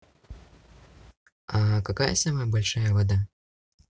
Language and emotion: Russian, neutral